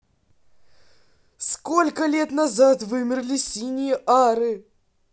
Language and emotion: Russian, neutral